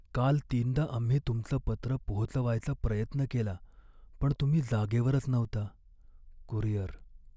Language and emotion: Marathi, sad